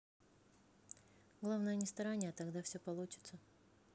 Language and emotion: Russian, neutral